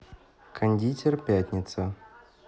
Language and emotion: Russian, neutral